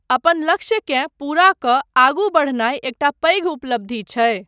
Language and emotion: Maithili, neutral